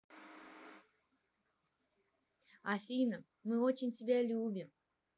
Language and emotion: Russian, positive